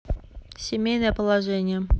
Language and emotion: Russian, neutral